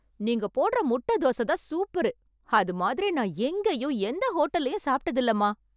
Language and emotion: Tamil, happy